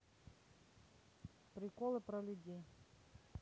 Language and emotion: Russian, neutral